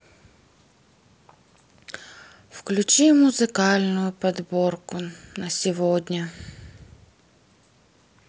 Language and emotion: Russian, sad